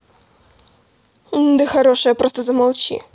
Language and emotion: Russian, angry